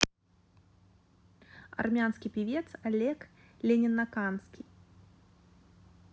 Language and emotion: Russian, neutral